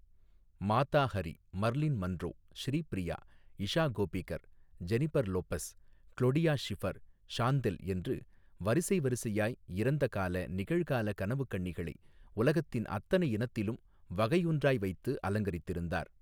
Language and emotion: Tamil, neutral